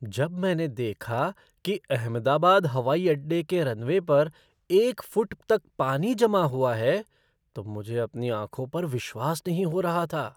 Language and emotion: Hindi, surprised